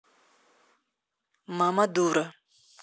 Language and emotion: Russian, neutral